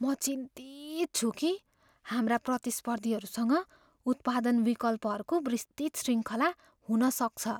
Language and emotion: Nepali, fearful